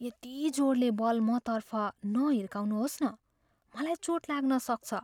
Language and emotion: Nepali, fearful